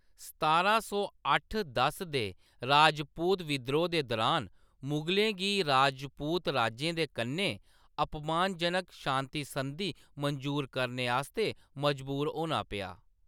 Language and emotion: Dogri, neutral